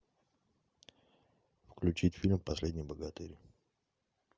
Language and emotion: Russian, neutral